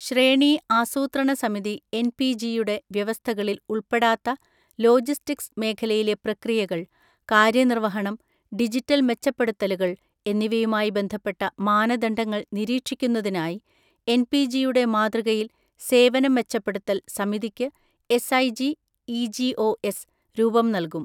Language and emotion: Malayalam, neutral